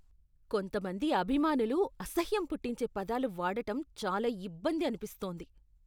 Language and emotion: Telugu, disgusted